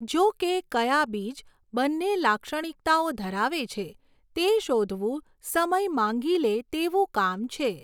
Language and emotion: Gujarati, neutral